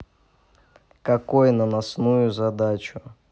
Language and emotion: Russian, neutral